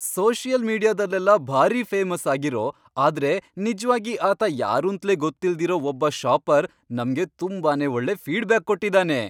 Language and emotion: Kannada, happy